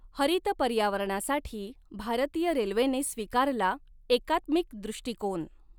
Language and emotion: Marathi, neutral